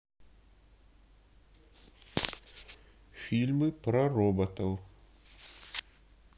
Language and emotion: Russian, neutral